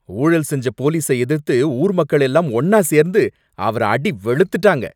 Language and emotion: Tamil, angry